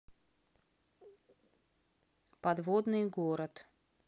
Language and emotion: Russian, neutral